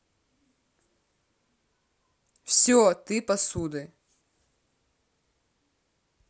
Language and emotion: Russian, neutral